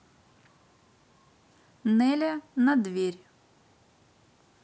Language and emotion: Russian, neutral